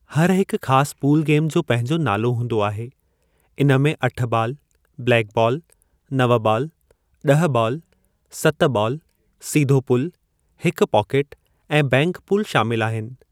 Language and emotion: Sindhi, neutral